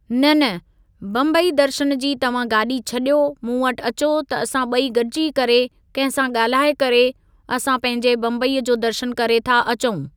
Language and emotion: Sindhi, neutral